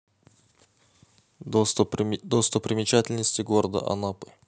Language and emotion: Russian, neutral